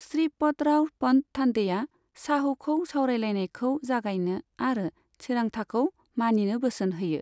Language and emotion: Bodo, neutral